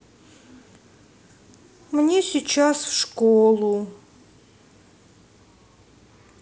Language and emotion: Russian, sad